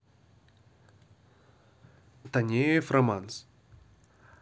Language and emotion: Russian, neutral